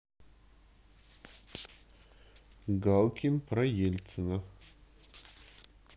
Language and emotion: Russian, neutral